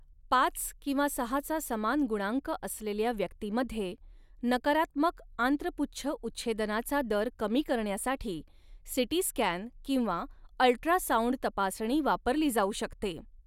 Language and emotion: Marathi, neutral